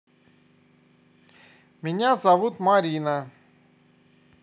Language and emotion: Russian, positive